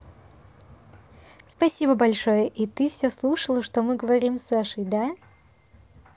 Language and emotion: Russian, positive